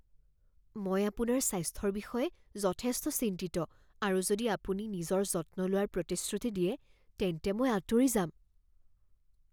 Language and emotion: Assamese, fearful